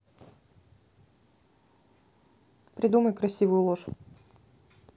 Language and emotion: Russian, neutral